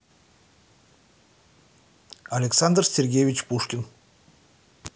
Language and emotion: Russian, neutral